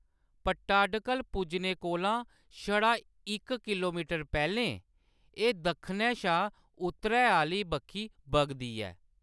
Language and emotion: Dogri, neutral